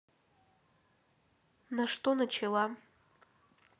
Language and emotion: Russian, neutral